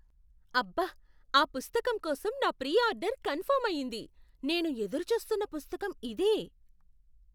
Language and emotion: Telugu, surprised